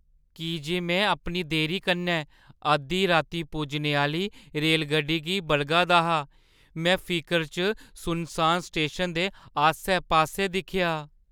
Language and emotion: Dogri, fearful